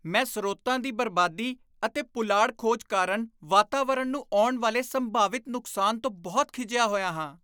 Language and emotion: Punjabi, disgusted